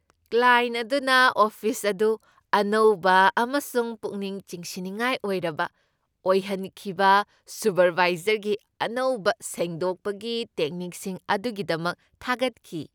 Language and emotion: Manipuri, happy